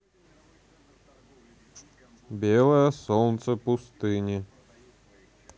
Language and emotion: Russian, neutral